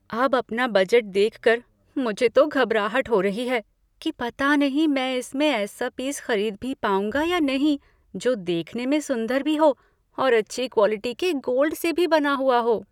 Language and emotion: Hindi, fearful